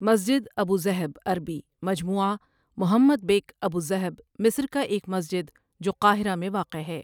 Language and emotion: Urdu, neutral